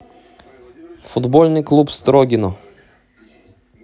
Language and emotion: Russian, neutral